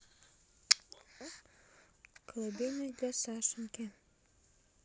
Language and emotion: Russian, neutral